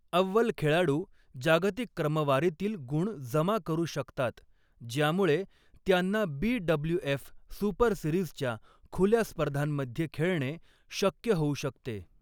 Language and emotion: Marathi, neutral